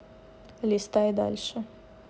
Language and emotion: Russian, neutral